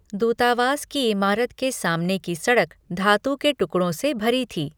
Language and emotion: Hindi, neutral